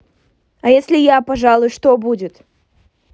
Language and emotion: Russian, angry